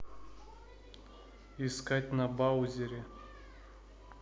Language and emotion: Russian, neutral